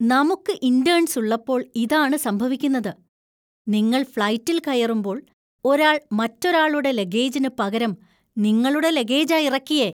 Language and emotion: Malayalam, disgusted